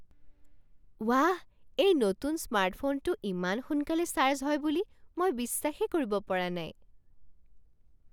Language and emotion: Assamese, surprised